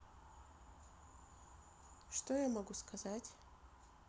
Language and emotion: Russian, neutral